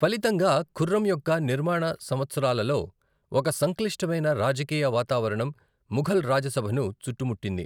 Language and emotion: Telugu, neutral